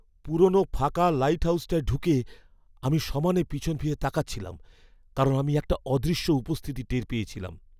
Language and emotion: Bengali, fearful